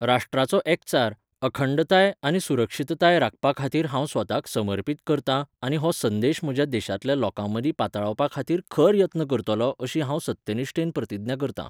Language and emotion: Goan Konkani, neutral